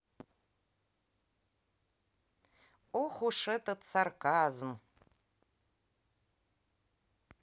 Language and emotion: Russian, angry